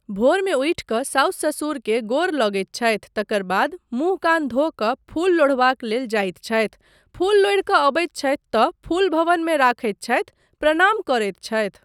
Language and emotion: Maithili, neutral